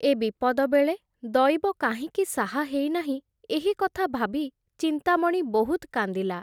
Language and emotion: Odia, neutral